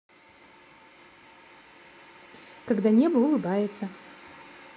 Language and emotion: Russian, positive